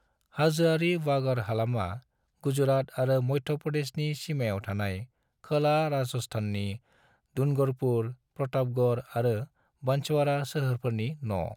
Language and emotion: Bodo, neutral